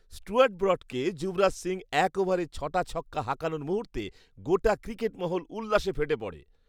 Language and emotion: Bengali, happy